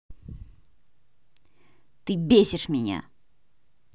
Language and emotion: Russian, angry